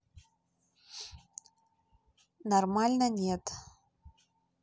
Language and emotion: Russian, neutral